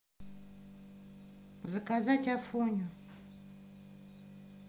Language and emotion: Russian, neutral